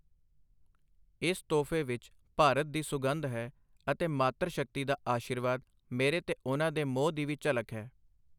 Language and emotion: Punjabi, neutral